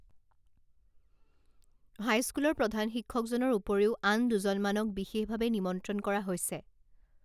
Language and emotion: Assamese, neutral